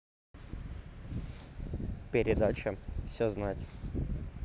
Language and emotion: Russian, neutral